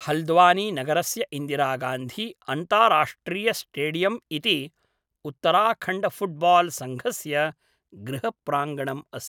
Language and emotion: Sanskrit, neutral